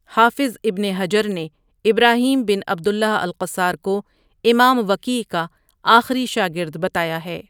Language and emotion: Urdu, neutral